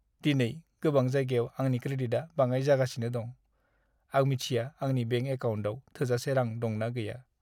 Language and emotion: Bodo, sad